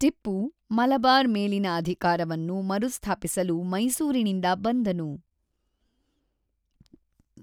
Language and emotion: Kannada, neutral